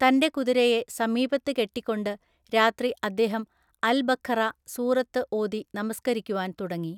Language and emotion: Malayalam, neutral